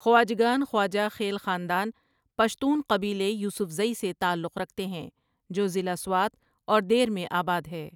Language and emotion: Urdu, neutral